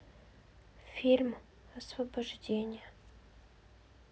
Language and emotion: Russian, sad